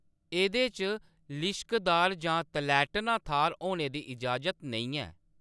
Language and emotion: Dogri, neutral